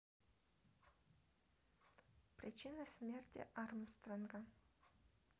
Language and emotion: Russian, neutral